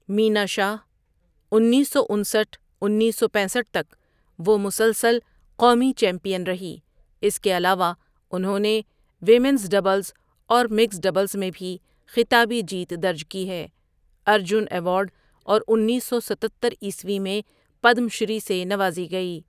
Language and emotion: Urdu, neutral